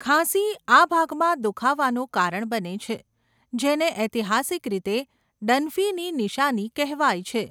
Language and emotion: Gujarati, neutral